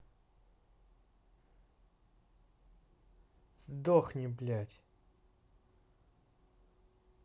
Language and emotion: Russian, angry